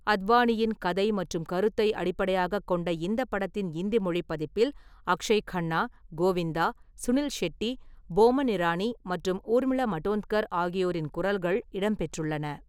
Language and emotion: Tamil, neutral